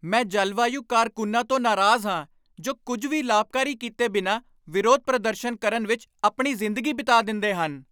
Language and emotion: Punjabi, angry